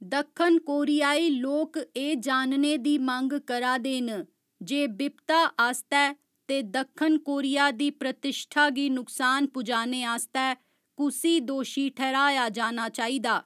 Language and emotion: Dogri, neutral